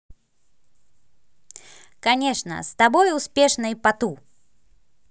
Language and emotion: Russian, positive